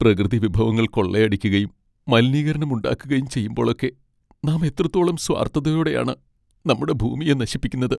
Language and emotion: Malayalam, sad